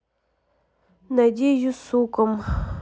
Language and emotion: Russian, neutral